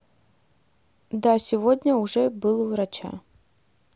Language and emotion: Russian, neutral